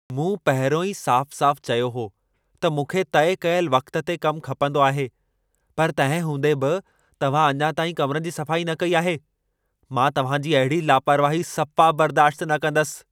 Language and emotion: Sindhi, angry